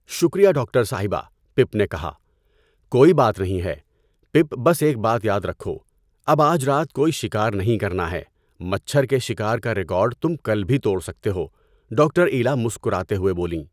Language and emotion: Urdu, neutral